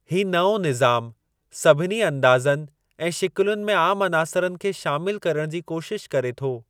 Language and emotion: Sindhi, neutral